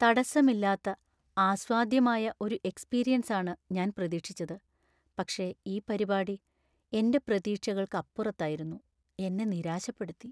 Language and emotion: Malayalam, sad